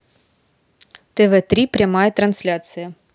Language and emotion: Russian, neutral